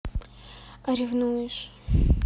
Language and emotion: Russian, neutral